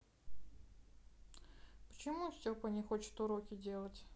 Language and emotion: Russian, sad